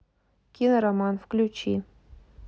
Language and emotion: Russian, neutral